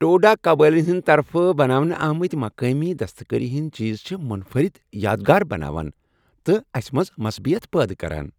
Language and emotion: Kashmiri, happy